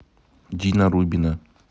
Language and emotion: Russian, neutral